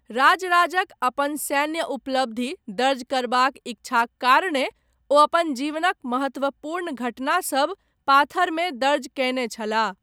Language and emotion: Maithili, neutral